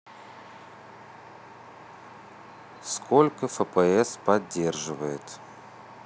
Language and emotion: Russian, neutral